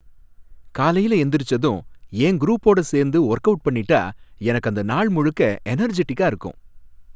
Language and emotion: Tamil, happy